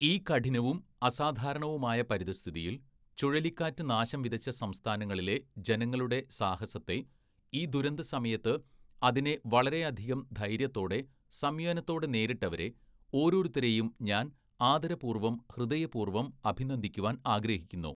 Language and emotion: Malayalam, neutral